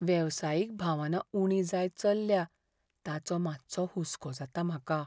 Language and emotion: Goan Konkani, fearful